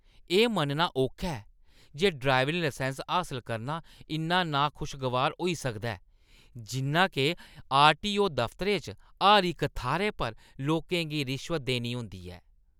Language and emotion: Dogri, disgusted